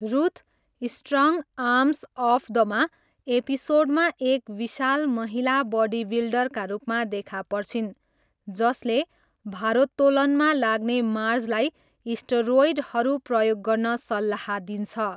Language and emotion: Nepali, neutral